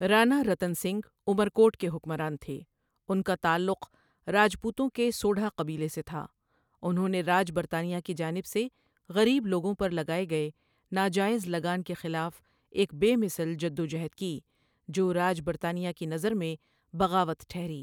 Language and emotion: Urdu, neutral